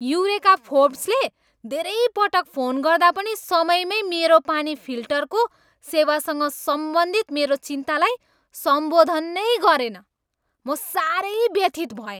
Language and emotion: Nepali, angry